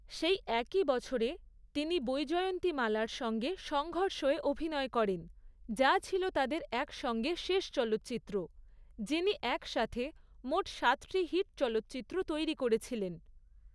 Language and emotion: Bengali, neutral